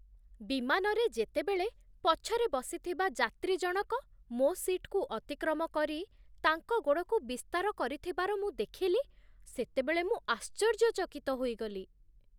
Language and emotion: Odia, surprised